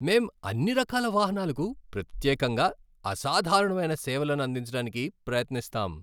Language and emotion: Telugu, happy